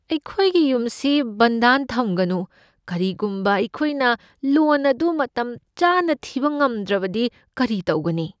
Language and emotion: Manipuri, fearful